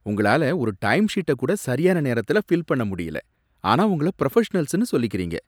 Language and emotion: Tamil, disgusted